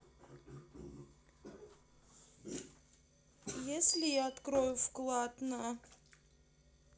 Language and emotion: Russian, sad